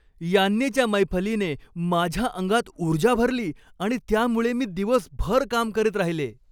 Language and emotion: Marathi, happy